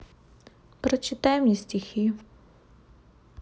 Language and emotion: Russian, sad